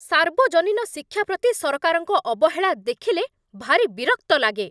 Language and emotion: Odia, angry